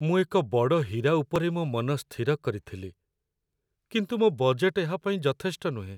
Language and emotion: Odia, sad